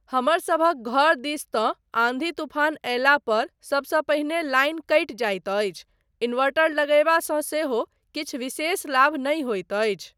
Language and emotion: Maithili, neutral